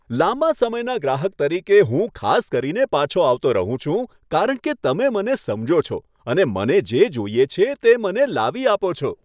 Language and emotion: Gujarati, happy